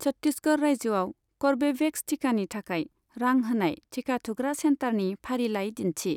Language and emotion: Bodo, neutral